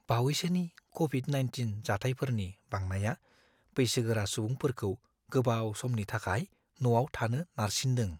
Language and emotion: Bodo, fearful